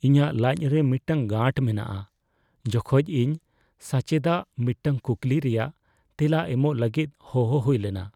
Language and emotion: Santali, fearful